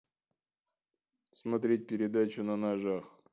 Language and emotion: Russian, neutral